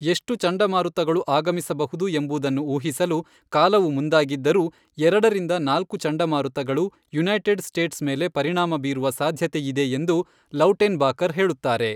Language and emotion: Kannada, neutral